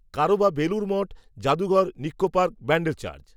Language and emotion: Bengali, neutral